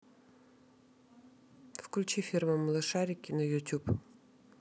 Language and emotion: Russian, neutral